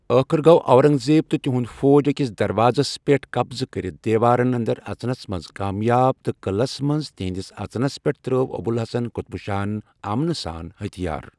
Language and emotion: Kashmiri, neutral